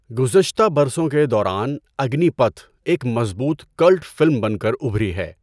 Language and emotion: Urdu, neutral